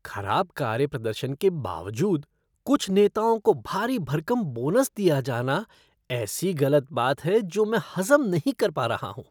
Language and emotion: Hindi, disgusted